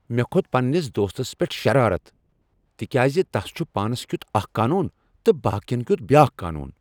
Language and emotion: Kashmiri, angry